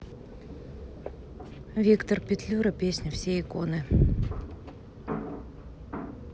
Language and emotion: Russian, neutral